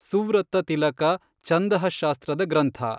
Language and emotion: Kannada, neutral